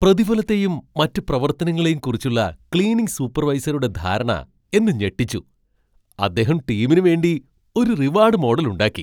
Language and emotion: Malayalam, surprised